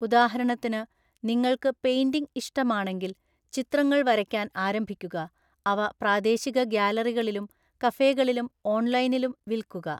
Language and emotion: Malayalam, neutral